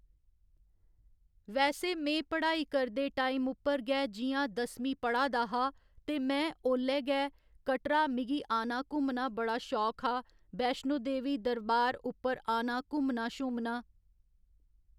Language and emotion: Dogri, neutral